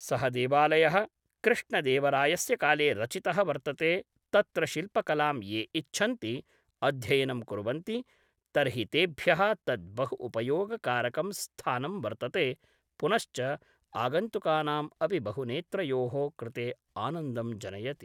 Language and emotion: Sanskrit, neutral